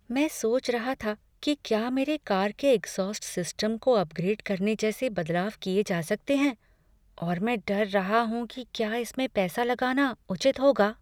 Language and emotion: Hindi, fearful